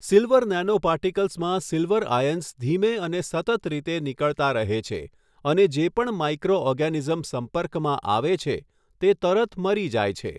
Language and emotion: Gujarati, neutral